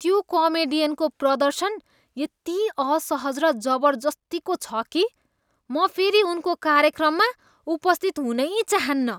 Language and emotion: Nepali, disgusted